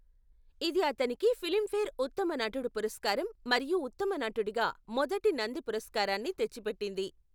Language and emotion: Telugu, neutral